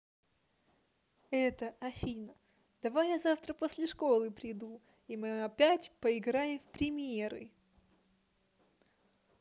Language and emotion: Russian, positive